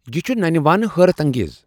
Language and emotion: Kashmiri, surprised